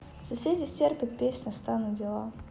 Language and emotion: Russian, neutral